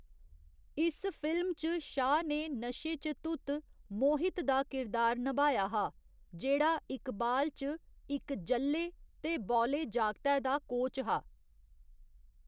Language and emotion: Dogri, neutral